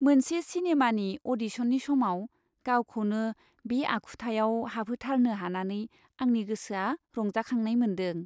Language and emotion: Bodo, happy